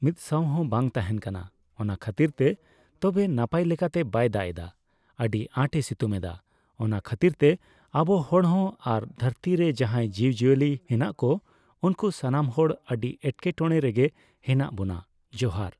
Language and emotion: Santali, neutral